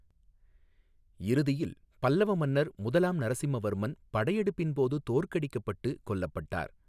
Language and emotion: Tamil, neutral